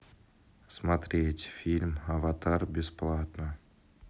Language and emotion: Russian, neutral